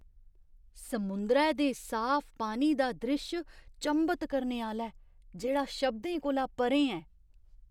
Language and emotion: Dogri, surprised